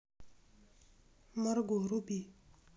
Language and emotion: Russian, neutral